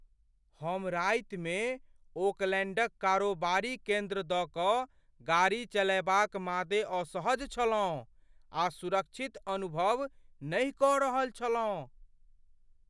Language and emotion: Maithili, fearful